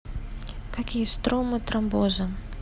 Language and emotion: Russian, neutral